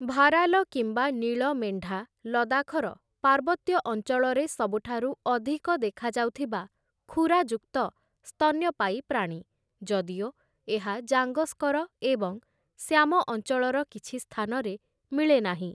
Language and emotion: Odia, neutral